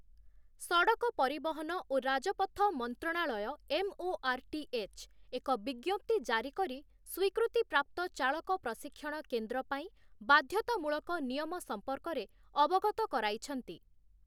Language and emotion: Odia, neutral